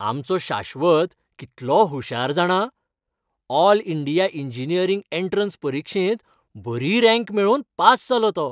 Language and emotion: Goan Konkani, happy